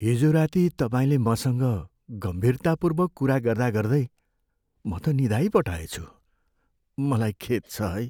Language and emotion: Nepali, sad